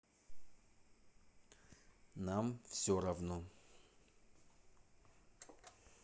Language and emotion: Russian, neutral